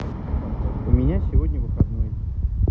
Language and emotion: Russian, neutral